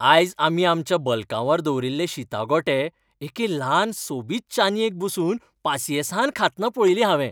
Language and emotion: Goan Konkani, happy